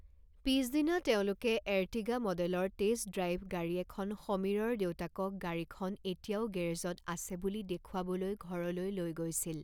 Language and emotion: Assamese, neutral